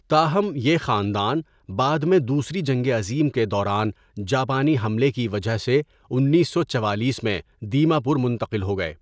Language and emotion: Urdu, neutral